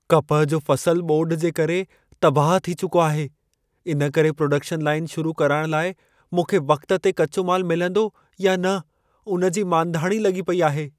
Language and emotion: Sindhi, fearful